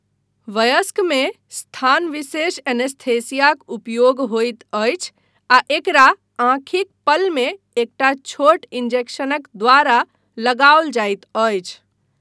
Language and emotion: Maithili, neutral